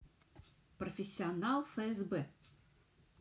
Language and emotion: Russian, neutral